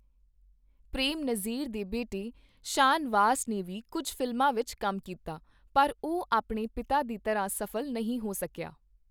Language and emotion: Punjabi, neutral